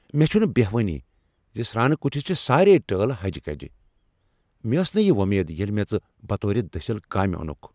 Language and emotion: Kashmiri, angry